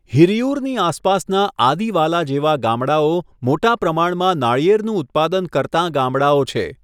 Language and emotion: Gujarati, neutral